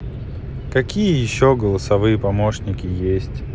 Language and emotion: Russian, sad